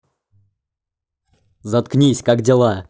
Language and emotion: Russian, angry